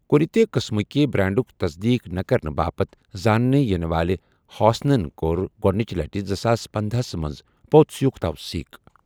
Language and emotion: Kashmiri, neutral